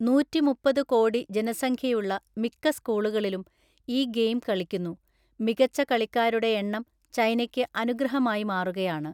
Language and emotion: Malayalam, neutral